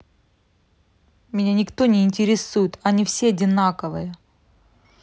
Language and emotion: Russian, angry